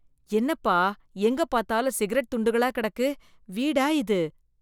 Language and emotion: Tamil, disgusted